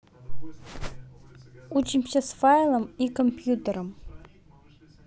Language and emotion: Russian, neutral